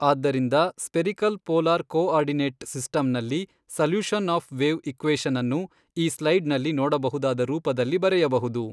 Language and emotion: Kannada, neutral